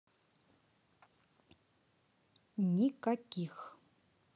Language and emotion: Russian, neutral